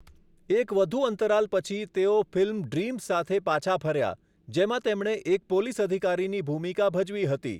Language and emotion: Gujarati, neutral